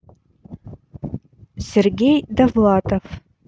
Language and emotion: Russian, neutral